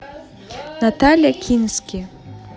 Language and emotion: Russian, neutral